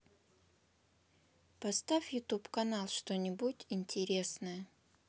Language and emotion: Russian, neutral